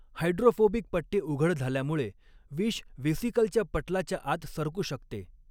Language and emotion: Marathi, neutral